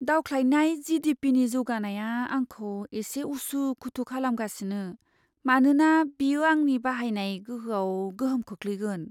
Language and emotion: Bodo, fearful